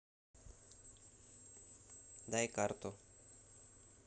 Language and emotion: Russian, neutral